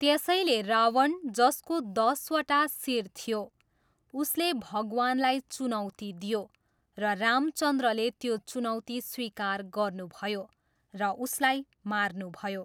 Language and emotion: Nepali, neutral